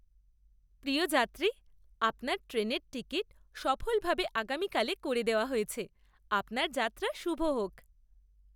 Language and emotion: Bengali, happy